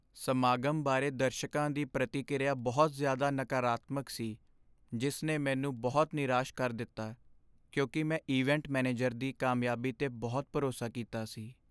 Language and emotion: Punjabi, sad